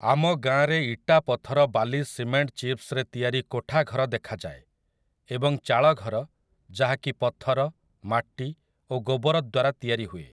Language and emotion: Odia, neutral